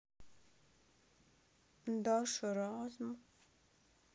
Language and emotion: Russian, sad